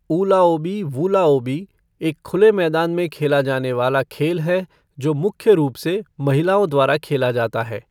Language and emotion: Hindi, neutral